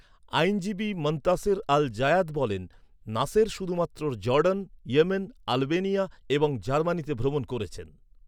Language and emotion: Bengali, neutral